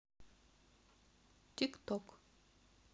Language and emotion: Russian, neutral